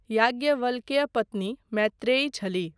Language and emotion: Maithili, neutral